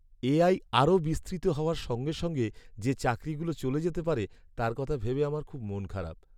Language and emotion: Bengali, sad